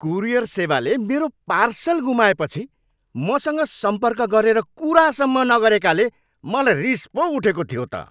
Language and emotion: Nepali, angry